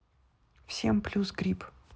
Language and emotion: Russian, neutral